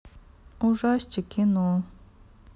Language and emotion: Russian, sad